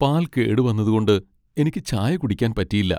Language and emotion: Malayalam, sad